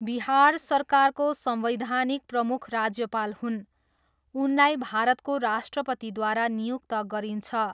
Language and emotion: Nepali, neutral